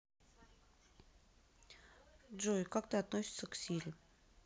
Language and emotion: Russian, neutral